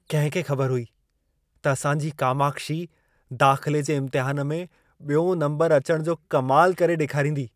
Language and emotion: Sindhi, surprised